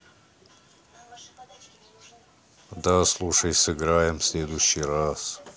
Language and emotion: Russian, neutral